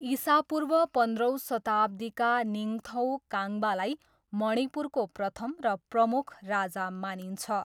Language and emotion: Nepali, neutral